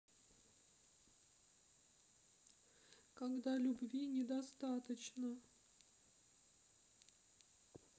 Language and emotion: Russian, sad